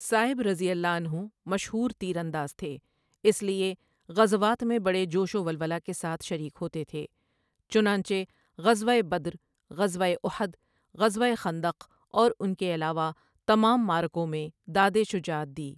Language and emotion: Urdu, neutral